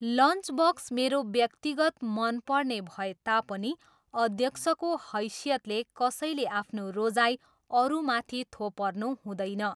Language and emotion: Nepali, neutral